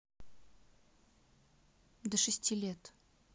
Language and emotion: Russian, neutral